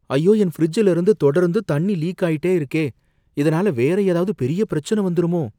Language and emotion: Tamil, fearful